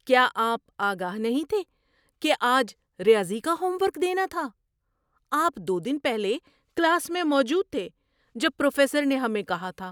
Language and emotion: Urdu, surprised